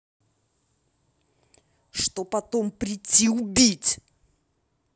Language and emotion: Russian, angry